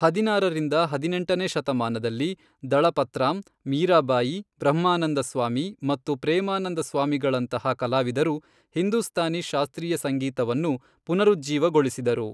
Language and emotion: Kannada, neutral